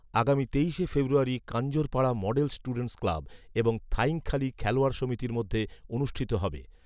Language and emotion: Bengali, neutral